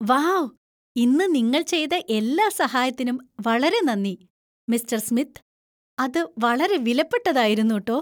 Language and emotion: Malayalam, happy